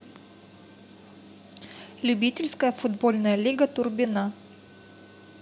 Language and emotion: Russian, neutral